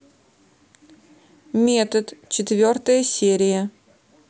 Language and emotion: Russian, neutral